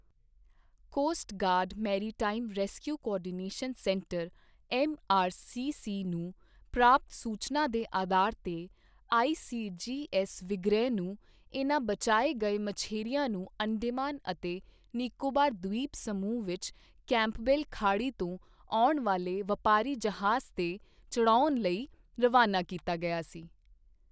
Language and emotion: Punjabi, neutral